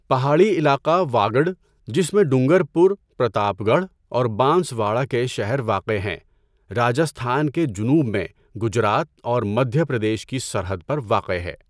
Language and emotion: Urdu, neutral